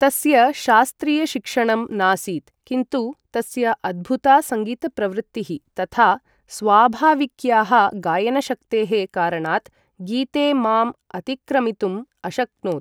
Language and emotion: Sanskrit, neutral